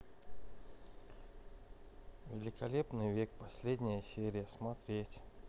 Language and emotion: Russian, neutral